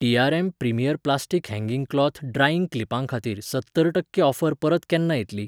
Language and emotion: Goan Konkani, neutral